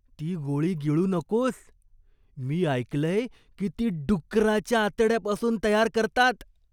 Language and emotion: Marathi, disgusted